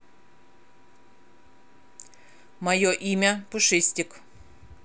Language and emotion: Russian, neutral